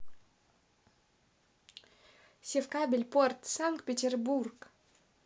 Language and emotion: Russian, positive